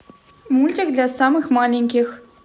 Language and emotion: Russian, positive